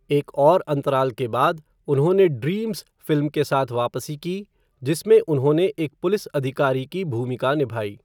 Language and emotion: Hindi, neutral